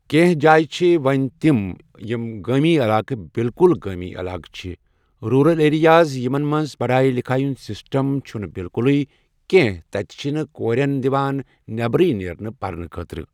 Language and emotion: Kashmiri, neutral